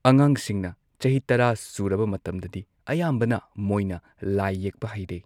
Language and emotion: Manipuri, neutral